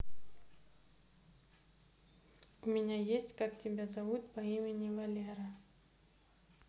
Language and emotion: Russian, neutral